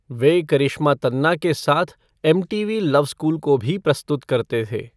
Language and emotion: Hindi, neutral